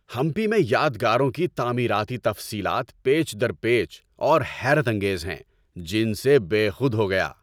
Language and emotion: Urdu, happy